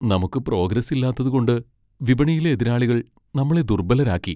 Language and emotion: Malayalam, sad